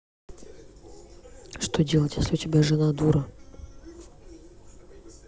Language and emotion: Russian, neutral